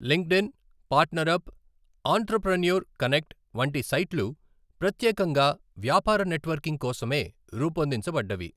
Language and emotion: Telugu, neutral